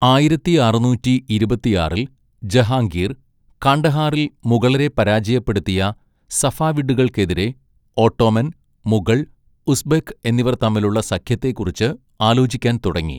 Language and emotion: Malayalam, neutral